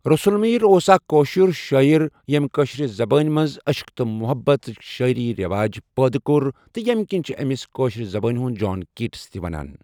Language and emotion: Kashmiri, neutral